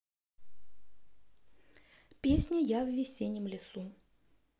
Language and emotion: Russian, neutral